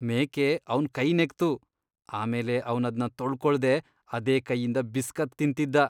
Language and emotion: Kannada, disgusted